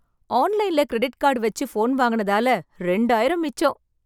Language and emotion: Tamil, happy